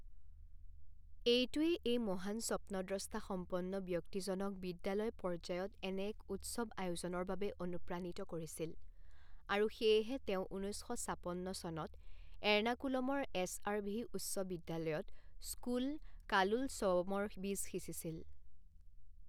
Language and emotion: Assamese, neutral